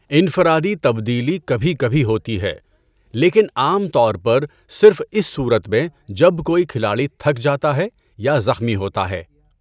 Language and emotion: Urdu, neutral